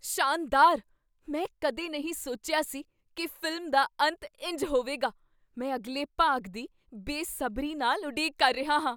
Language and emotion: Punjabi, surprised